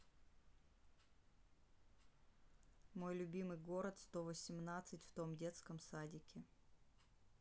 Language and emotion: Russian, neutral